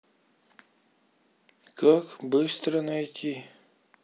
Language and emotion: Russian, sad